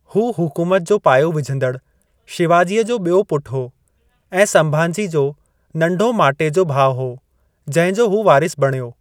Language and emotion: Sindhi, neutral